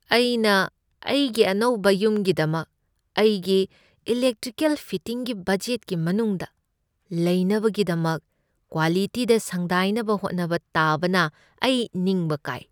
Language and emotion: Manipuri, sad